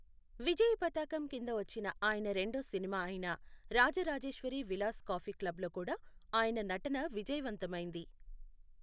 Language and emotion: Telugu, neutral